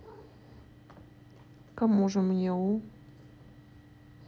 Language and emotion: Russian, neutral